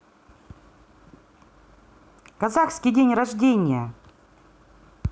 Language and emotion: Russian, positive